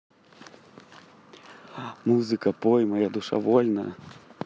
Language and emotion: Russian, positive